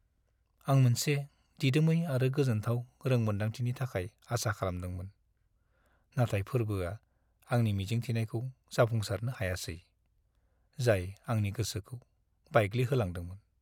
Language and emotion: Bodo, sad